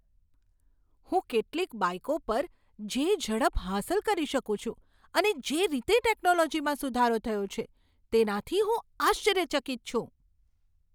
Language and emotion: Gujarati, surprised